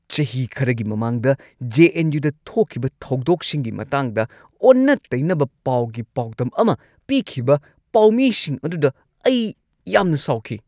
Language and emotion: Manipuri, angry